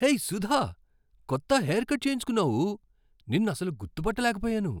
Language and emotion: Telugu, surprised